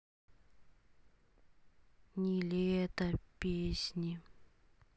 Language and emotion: Russian, sad